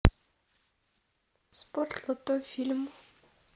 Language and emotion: Russian, neutral